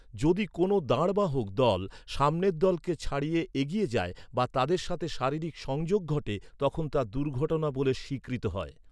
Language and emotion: Bengali, neutral